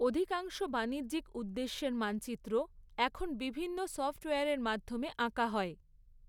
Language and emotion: Bengali, neutral